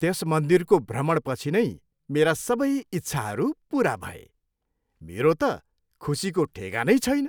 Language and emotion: Nepali, happy